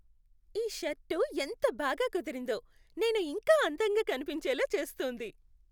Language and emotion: Telugu, happy